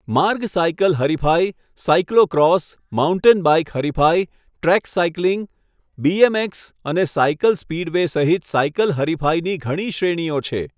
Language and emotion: Gujarati, neutral